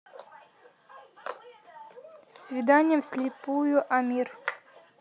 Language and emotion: Russian, neutral